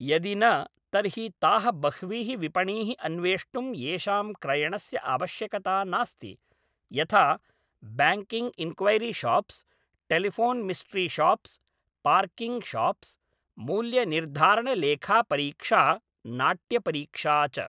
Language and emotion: Sanskrit, neutral